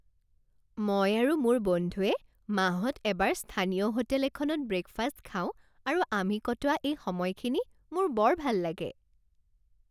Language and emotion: Assamese, happy